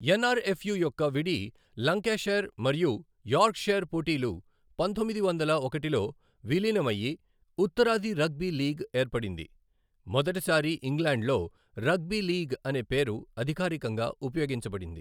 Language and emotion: Telugu, neutral